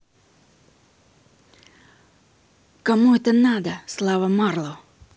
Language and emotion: Russian, angry